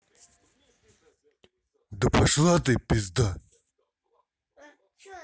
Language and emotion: Russian, angry